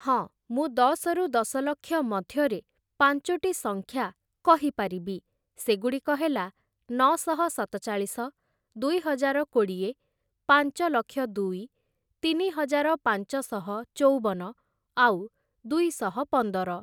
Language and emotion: Odia, neutral